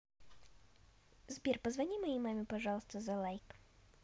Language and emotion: Russian, neutral